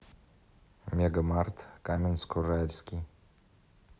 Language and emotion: Russian, neutral